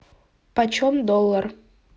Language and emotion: Russian, neutral